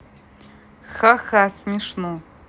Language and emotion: Russian, neutral